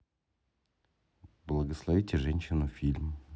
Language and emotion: Russian, neutral